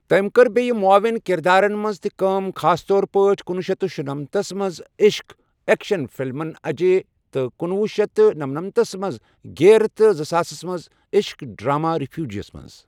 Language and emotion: Kashmiri, neutral